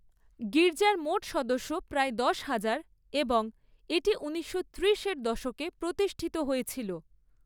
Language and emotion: Bengali, neutral